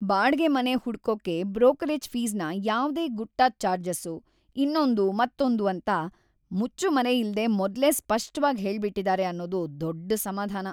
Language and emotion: Kannada, happy